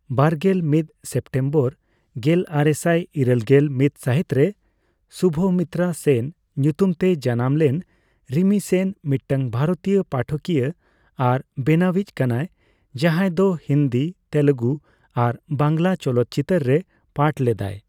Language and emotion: Santali, neutral